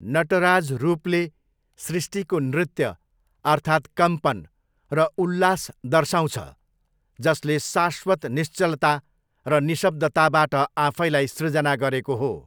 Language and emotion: Nepali, neutral